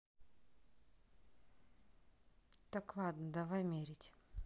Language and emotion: Russian, neutral